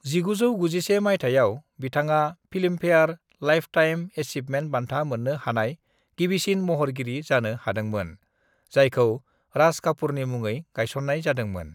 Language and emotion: Bodo, neutral